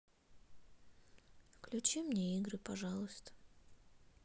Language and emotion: Russian, sad